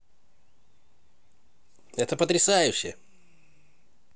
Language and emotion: Russian, positive